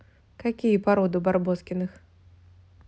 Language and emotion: Russian, neutral